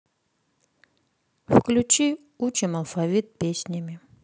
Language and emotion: Russian, sad